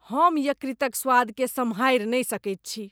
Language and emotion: Maithili, disgusted